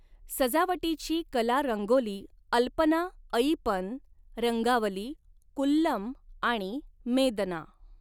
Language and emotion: Marathi, neutral